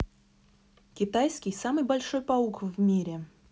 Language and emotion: Russian, neutral